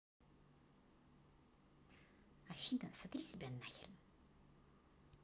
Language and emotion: Russian, neutral